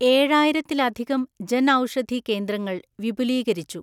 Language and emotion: Malayalam, neutral